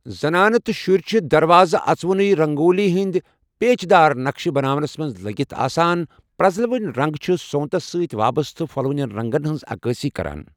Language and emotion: Kashmiri, neutral